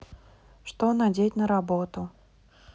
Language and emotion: Russian, neutral